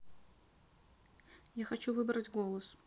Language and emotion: Russian, neutral